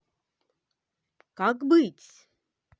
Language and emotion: Russian, positive